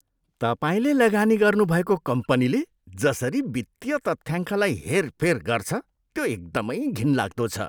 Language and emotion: Nepali, disgusted